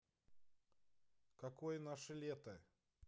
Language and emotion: Russian, neutral